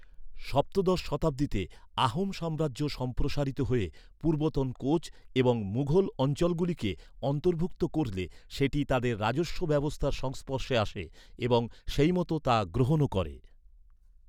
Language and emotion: Bengali, neutral